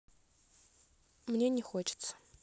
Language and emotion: Russian, neutral